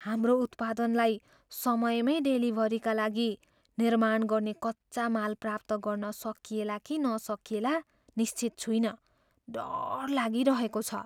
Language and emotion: Nepali, fearful